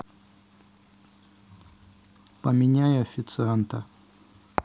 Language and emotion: Russian, neutral